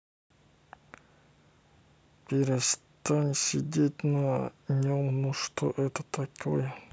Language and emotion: Russian, neutral